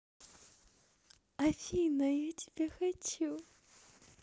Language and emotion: Russian, positive